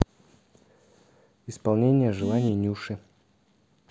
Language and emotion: Russian, neutral